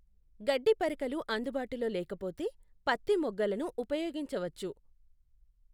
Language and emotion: Telugu, neutral